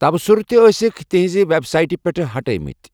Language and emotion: Kashmiri, neutral